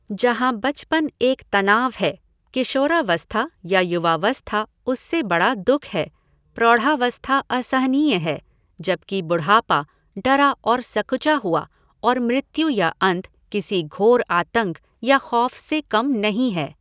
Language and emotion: Hindi, neutral